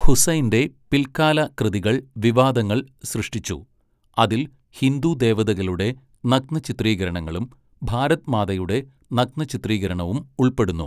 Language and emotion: Malayalam, neutral